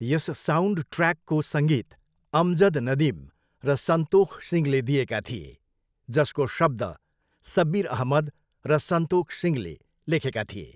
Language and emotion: Nepali, neutral